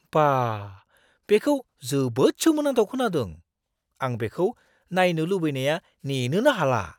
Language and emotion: Bodo, surprised